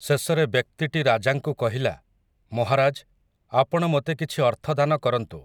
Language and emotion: Odia, neutral